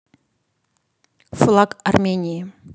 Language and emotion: Russian, neutral